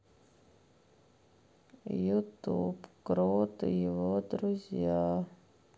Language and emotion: Russian, sad